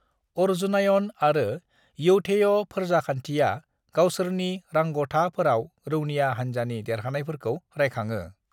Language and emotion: Bodo, neutral